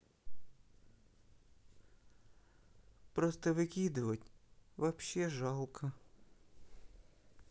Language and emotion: Russian, sad